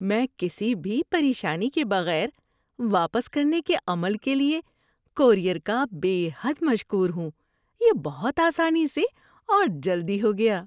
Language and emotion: Urdu, happy